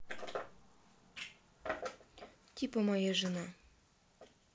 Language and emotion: Russian, neutral